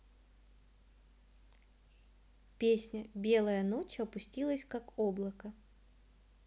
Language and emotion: Russian, neutral